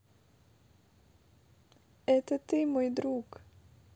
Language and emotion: Russian, neutral